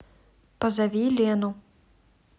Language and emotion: Russian, neutral